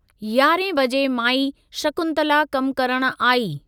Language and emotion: Sindhi, neutral